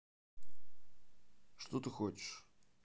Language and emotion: Russian, neutral